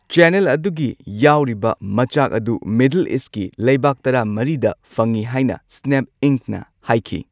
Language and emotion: Manipuri, neutral